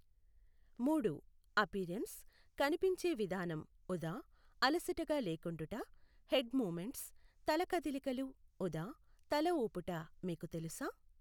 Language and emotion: Telugu, neutral